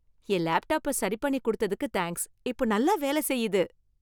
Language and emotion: Tamil, happy